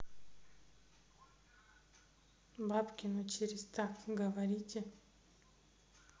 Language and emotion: Russian, neutral